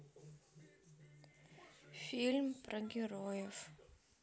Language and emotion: Russian, sad